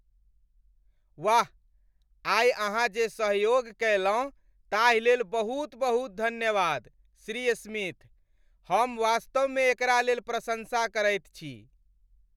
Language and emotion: Maithili, happy